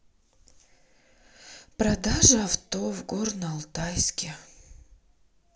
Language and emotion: Russian, sad